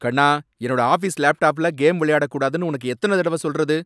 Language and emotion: Tamil, angry